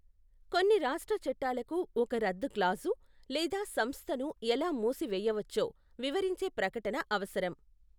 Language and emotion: Telugu, neutral